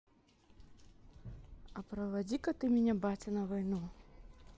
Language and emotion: Russian, neutral